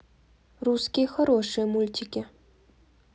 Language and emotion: Russian, neutral